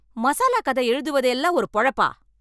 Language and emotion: Tamil, angry